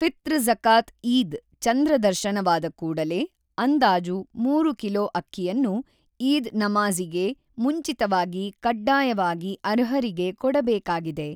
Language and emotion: Kannada, neutral